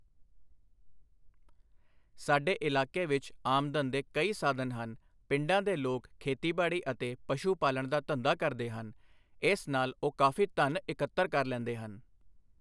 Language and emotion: Punjabi, neutral